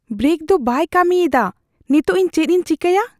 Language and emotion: Santali, fearful